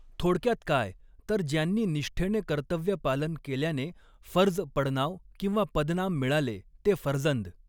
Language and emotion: Marathi, neutral